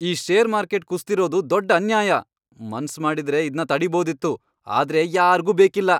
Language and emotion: Kannada, angry